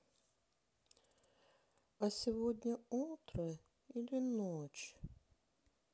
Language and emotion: Russian, sad